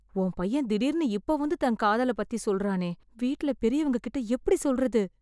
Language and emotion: Tamil, fearful